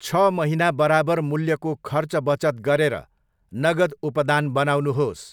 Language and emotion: Nepali, neutral